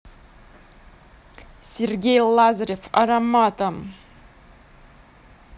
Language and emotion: Russian, positive